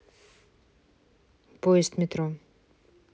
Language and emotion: Russian, neutral